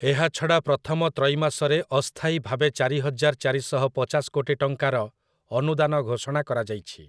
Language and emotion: Odia, neutral